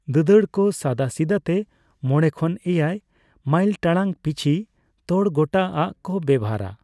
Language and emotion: Santali, neutral